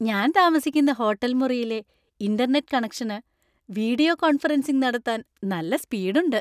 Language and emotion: Malayalam, happy